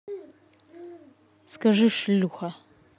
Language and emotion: Russian, angry